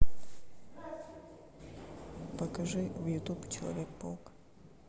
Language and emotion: Russian, neutral